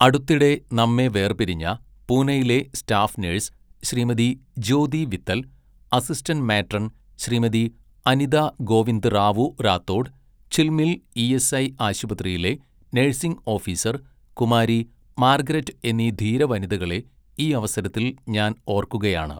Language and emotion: Malayalam, neutral